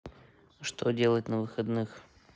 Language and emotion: Russian, neutral